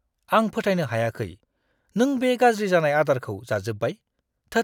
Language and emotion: Bodo, disgusted